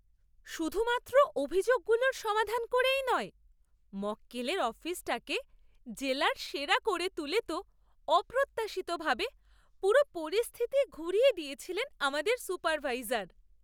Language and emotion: Bengali, surprised